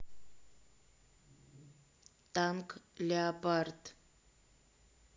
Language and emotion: Russian, neutral